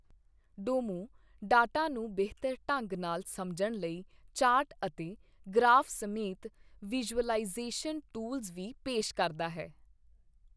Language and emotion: Punjabi, neutral